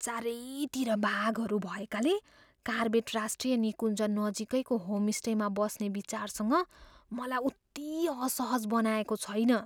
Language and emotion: Nepali, fearful